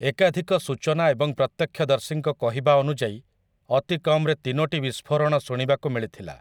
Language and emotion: Odia, neutral